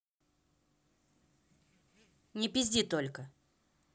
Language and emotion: Russian, angry